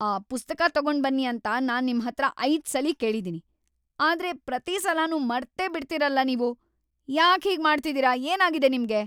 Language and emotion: Kannada, angry